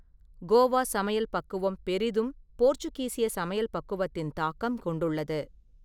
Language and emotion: Tamil, neutral